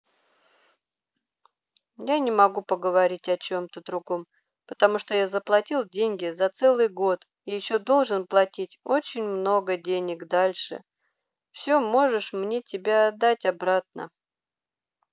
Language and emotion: Russian, sad